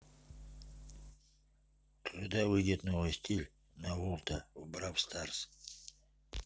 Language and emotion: Russian, neutral